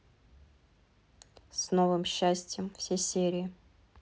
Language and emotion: Russian, neutral